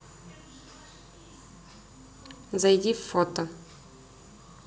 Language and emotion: Russian, neutral